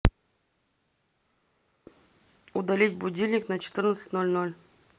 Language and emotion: Russian, neutral